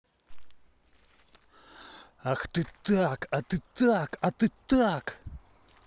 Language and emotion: Russian, angry